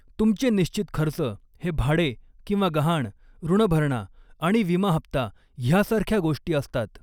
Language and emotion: Marathi, neutral